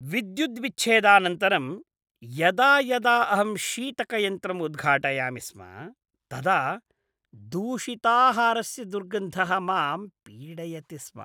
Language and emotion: Sanskrit, disgusted